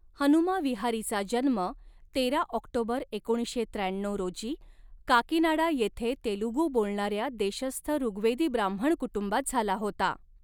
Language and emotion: Marathi, neutral